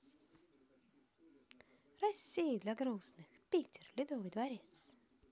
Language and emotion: Russian, neutral